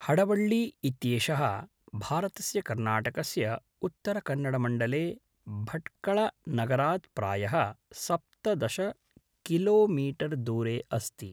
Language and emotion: Sanskrit, neutral